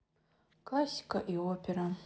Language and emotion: Russian, sad